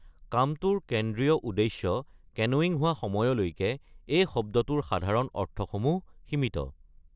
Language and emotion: Assamese, neutral